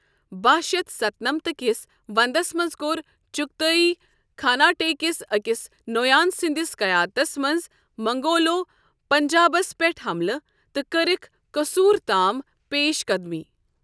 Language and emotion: Kashmiri, neutral